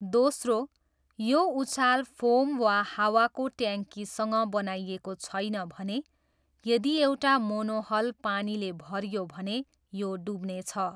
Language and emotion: Nepali, neutral